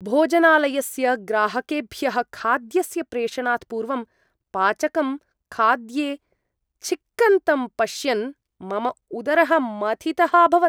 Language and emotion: Sanskrit, disgusted